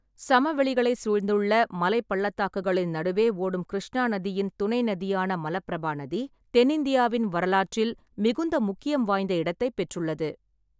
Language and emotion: Tamil, neutral